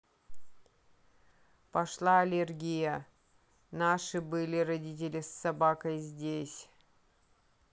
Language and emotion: Russian, neutral